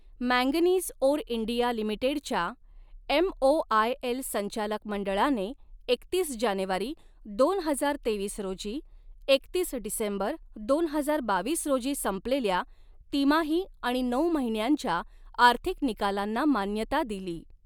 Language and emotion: Marathi, neutral